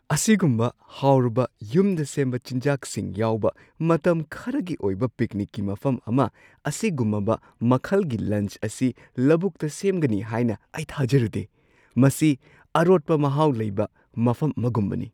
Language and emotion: Manipuri, surprised